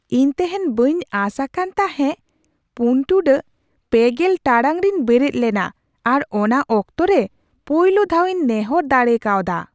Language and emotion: Santali, surprised